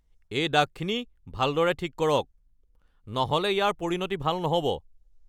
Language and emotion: Assamese, angry